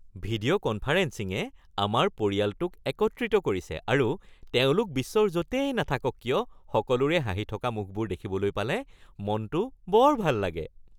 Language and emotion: Assamese, happy